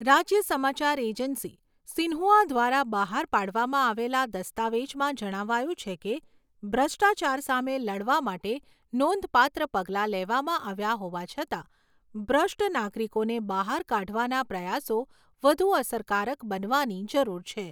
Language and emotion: Gujarati, neutral